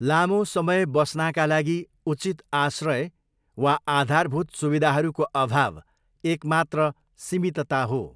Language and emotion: Nepali, neutral